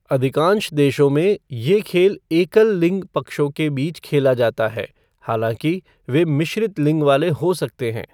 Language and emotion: Hindi, neutral